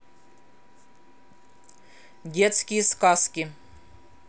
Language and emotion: Russian, neutral